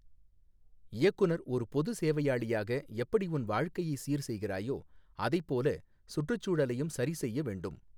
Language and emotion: Tamil, neutral